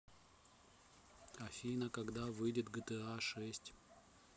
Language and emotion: Russian, neutral